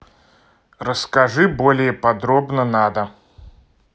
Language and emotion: Russian, neutral